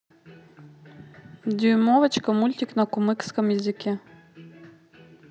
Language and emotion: Russian, neutral